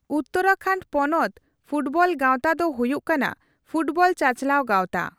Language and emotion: Santali, neutral